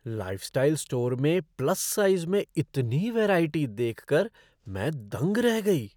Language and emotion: Hindi, surprised